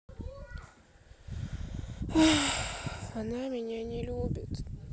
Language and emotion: Russian, sad